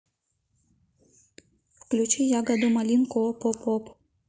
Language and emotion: Russian, neutral